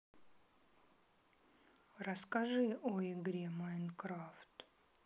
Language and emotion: Russian, sad